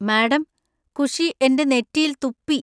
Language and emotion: Malayalam, disgusted